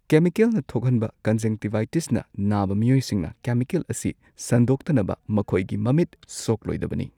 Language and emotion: Manipuri, neutral